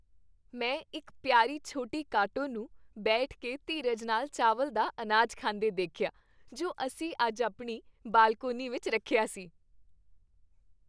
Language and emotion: Punjabi, happy